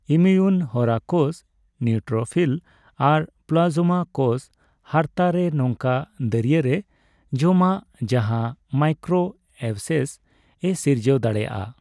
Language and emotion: Santali, neutral